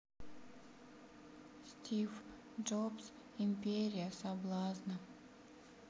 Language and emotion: Russian, sad